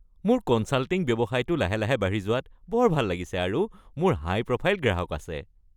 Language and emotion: Assamese, happy